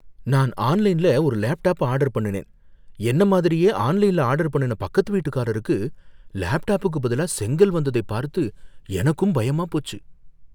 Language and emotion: Tamil, fearful